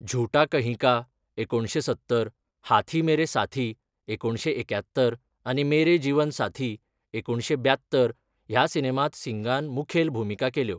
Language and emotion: Goan Konkani, neutral